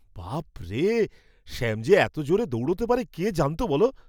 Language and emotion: Bengali, surprised